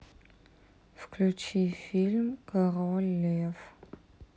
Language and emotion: Russian, neutral